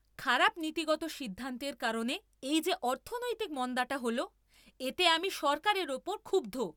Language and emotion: Bengali, angry